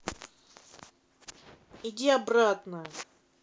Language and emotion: Russian, angry